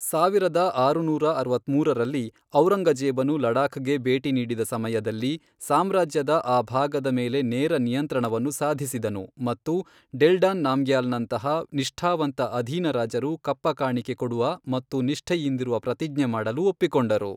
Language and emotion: Kannada, neutral